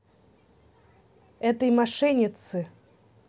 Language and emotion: Russian, neutral